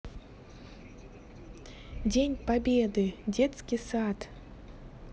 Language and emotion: Russian, positive